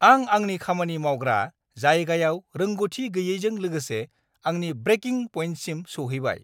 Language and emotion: Bodo, angry